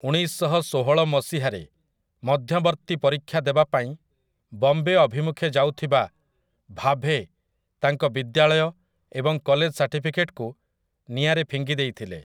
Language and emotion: Odia, neutral